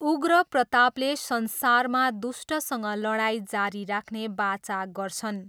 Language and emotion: Nepali, neutral